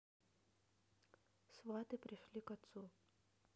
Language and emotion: Russian, neutral